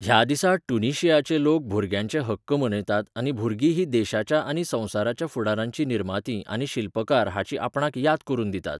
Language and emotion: Goan Konkani, neutral